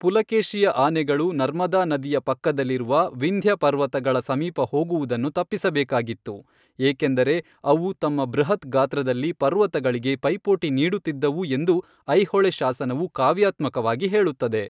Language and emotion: Kannada, neutral